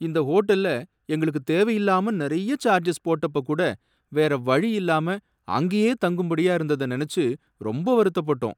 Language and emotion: Tamil, sad